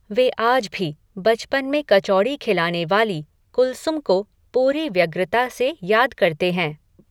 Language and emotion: Hindi, neutral